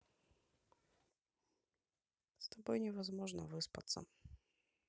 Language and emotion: Russian, neutral